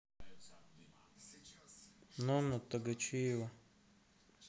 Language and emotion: Russian, neutral